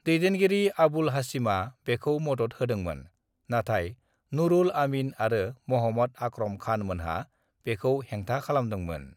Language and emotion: Bodo, neutral